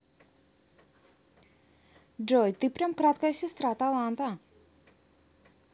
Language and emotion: Russian, positive